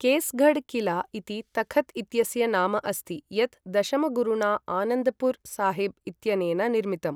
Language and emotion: Sanskrit, neutral